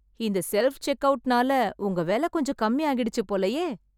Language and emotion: Tamil, surprised